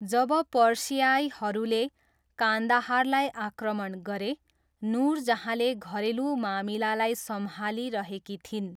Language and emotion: Nepali, neutral